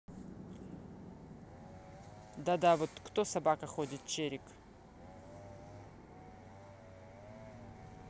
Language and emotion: Russian, neutral